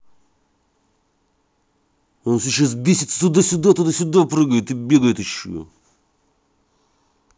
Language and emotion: Russian, angry